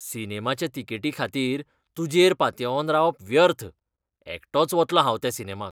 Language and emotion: Goan Konkani, disgusted